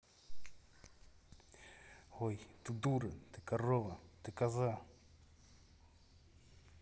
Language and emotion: Russian, angry